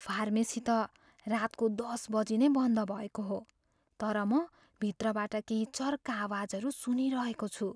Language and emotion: Nepali, fearful